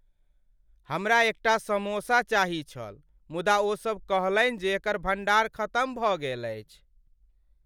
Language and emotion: Maithili, sad